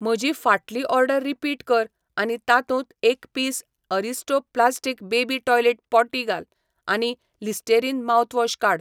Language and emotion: Goan Konkani, neutral